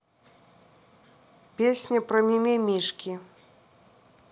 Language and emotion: Russian, neutral